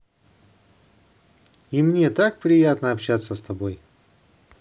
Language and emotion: Russian, positive